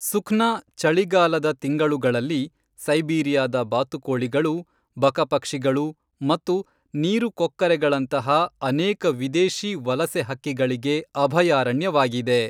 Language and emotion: Kannada, neutral